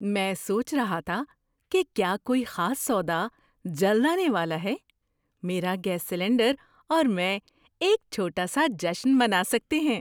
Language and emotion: Urdu, surprised